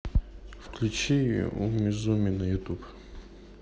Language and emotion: Russian, neutral